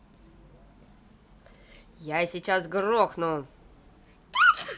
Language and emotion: Russian, angry